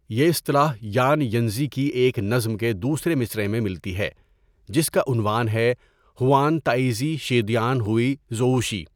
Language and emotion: Urdu, neutral